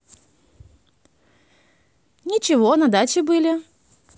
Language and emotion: Russian, positive